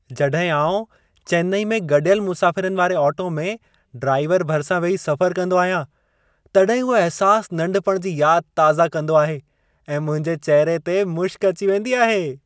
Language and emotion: Sindhi, happy